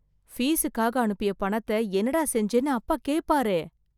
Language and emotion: Tamil, fearful